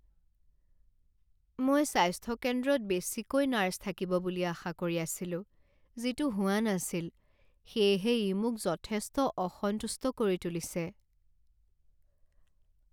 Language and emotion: Assamese, sad